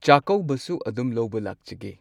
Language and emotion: Manipuri, neutral